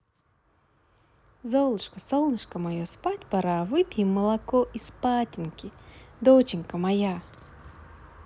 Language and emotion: Russian, positive